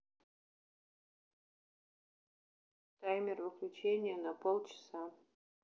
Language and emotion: Russian, neutral